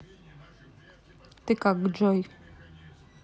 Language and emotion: Russian, neutral